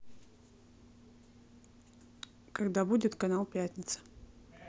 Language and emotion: Russian, neutral